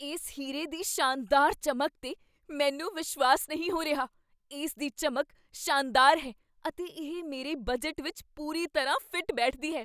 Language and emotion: Punjabi, surprised